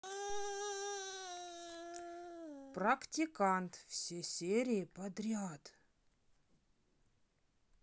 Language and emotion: Russian, neutral